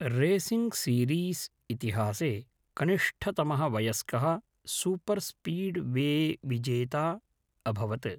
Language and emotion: Sanskrit, neutral